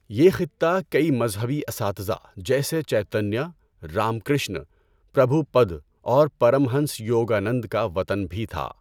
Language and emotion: Urdu, neutral